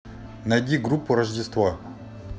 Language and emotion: Russian, neutral